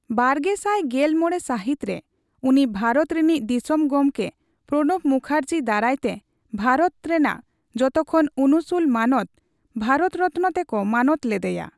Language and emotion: Santali, neutral